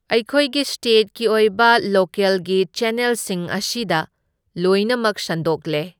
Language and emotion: Manipuri, neutral